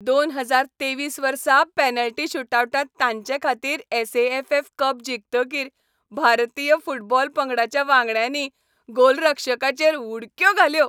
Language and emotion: Goan Konkani, happy